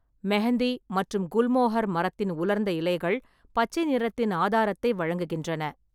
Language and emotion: Tamil, neutral